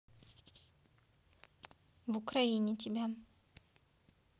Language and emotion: Russian, neutral